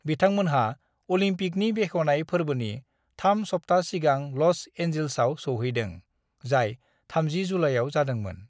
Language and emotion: Bodo, neutral